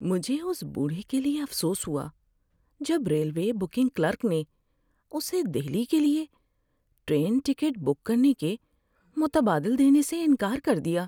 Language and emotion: Urdu, sad